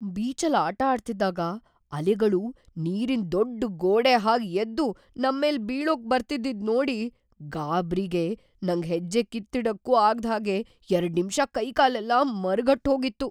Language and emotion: Kannada, fearful